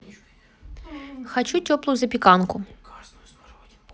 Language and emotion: Russian, neutral